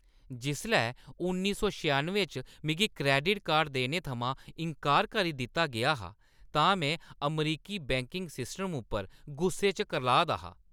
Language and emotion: Dogri, angry